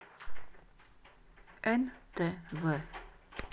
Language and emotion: Russian, neutral